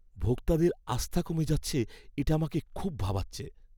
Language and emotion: Bengali, fearful